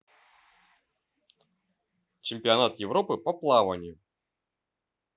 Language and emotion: Russian, neutral